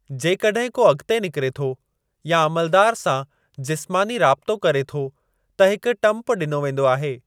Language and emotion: Sindhi, neutral